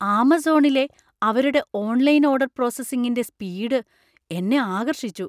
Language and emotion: Malayalam, surprised